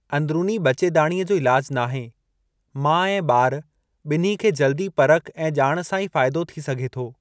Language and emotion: Sindhi, neutral